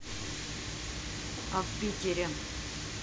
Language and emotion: Russian, neutral